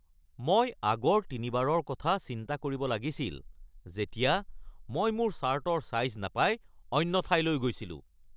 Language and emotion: Assamese, angry